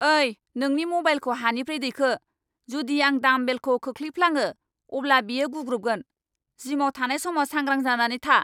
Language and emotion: Bodo, angry